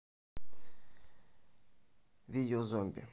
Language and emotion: Russian, neutral